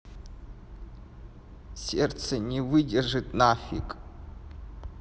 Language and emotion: Russian, sad